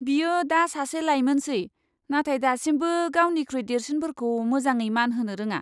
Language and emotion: Bodo, disgusted